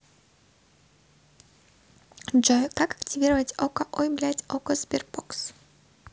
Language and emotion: Russian, positive